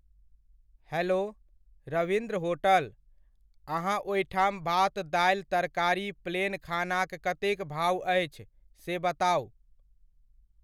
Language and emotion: Maithili, neutral